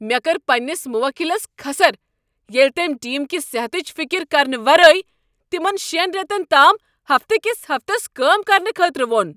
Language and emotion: Kashmiri, angry